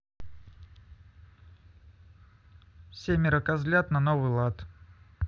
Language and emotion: Russian, neutral